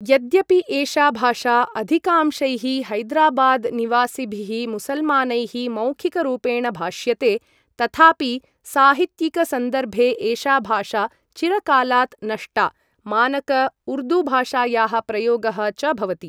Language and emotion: Sanskrit, neutral